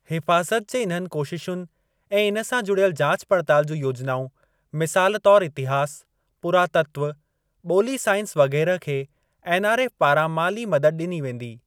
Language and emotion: Sindhi, neutral